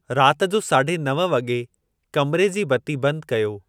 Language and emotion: Sindhi, neutral